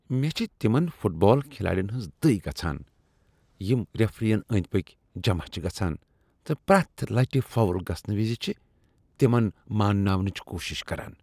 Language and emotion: Kashmiri, disgusted